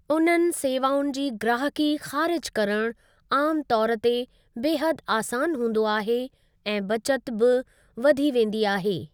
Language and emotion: Sindhi, neutral